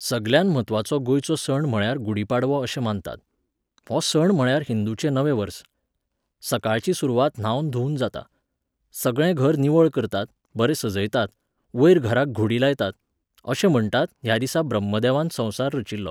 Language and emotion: Goan Konkani, neutral